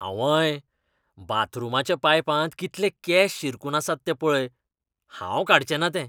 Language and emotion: Goan Konkani, disgusted